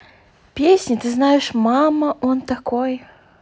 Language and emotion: Russian, neutral